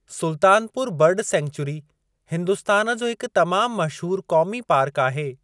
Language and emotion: Sindhi, neutral